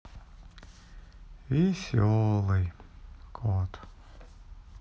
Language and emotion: Russian, sad